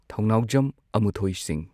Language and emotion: Manipuri, neutral